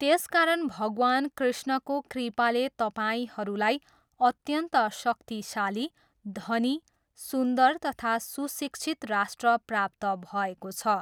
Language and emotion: Nepali, neutral